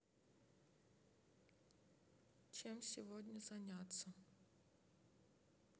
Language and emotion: Russian, sad